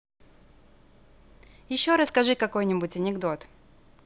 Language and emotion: Russian, positive